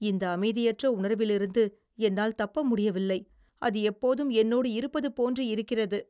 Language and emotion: Tamil, fearful